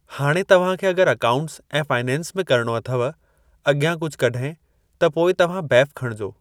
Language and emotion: Sindhi, neutral